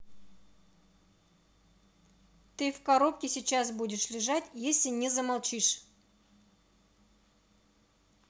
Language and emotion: Russian, angry